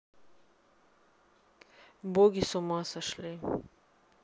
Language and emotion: Russian, neutral